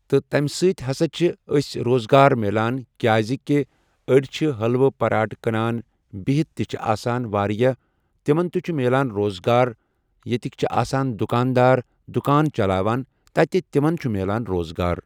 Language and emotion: Kashmiri, neutral